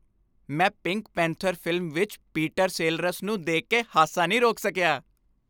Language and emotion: Punjabi, happy